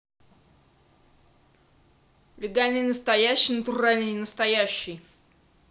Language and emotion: Russian, angry